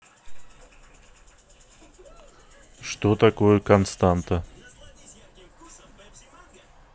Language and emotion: Russian, neutral